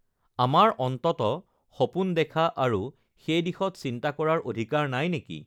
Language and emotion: Assamese, neutral